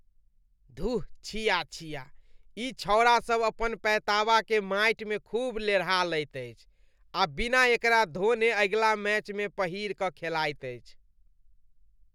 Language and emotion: Maithili, disgusted